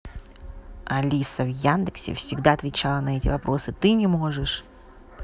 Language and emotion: Russian, neutral